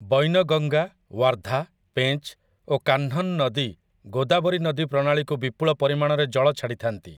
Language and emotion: Odia, neutral